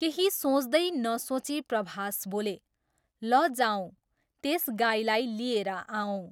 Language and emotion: Nepali, neutral